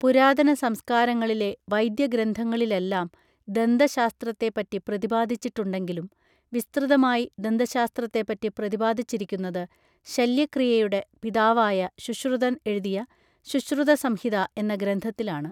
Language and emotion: Malayalam, neutral